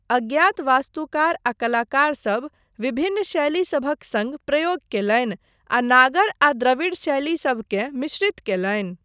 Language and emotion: Maithili, neutral